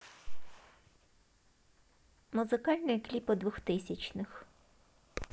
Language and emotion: Russian, neutral